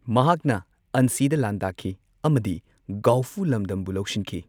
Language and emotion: Manipuri, neutral